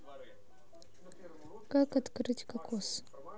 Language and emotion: Russian, neutral